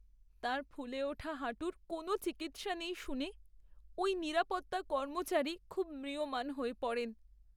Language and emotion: Bengali, sad